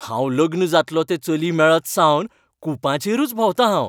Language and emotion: Goan Konkani, happy